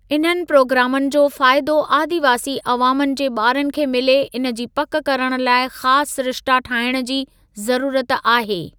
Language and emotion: Sindhi, neutral